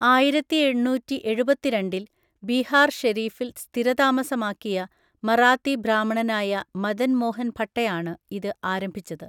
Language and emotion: Malayalam, neutral